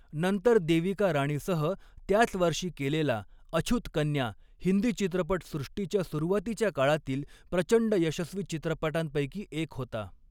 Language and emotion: Marathi, neutral